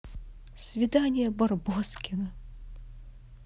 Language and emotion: Russian, positive